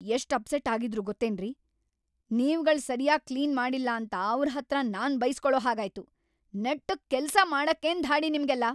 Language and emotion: Kannada, angry